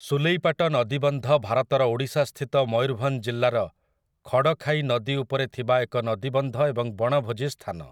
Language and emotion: Odia, neutral